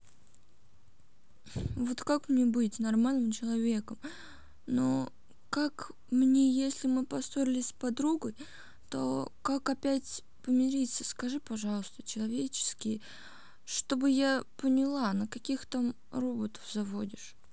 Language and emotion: Russian, sad